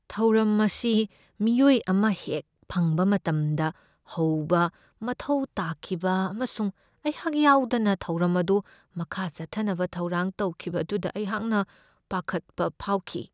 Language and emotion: Manipuri, fearful